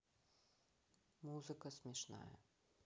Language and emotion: Russian, neutral